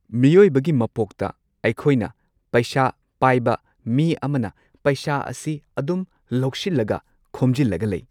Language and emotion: Manipuri, neutral